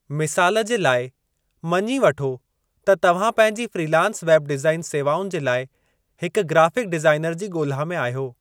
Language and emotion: Sindhi, neutral